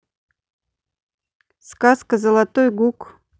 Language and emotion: Russian, neutral